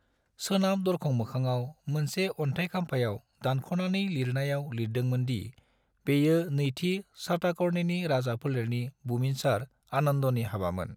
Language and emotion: Bodo, neutral